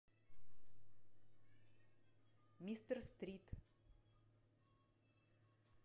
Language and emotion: Russian, neutral